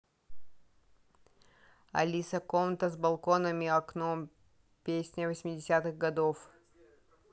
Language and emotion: Russian, neutral